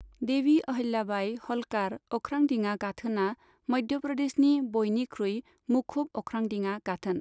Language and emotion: Bodo, neutral